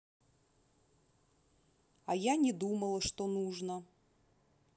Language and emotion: Russian, neutral